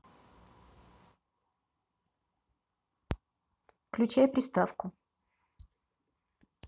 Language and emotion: Russian, neutral